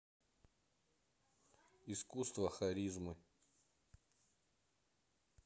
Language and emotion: Russian, neutral